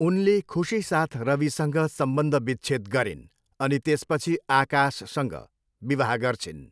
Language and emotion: Nepali, neutral